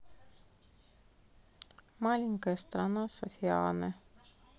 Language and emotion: Russian, neutral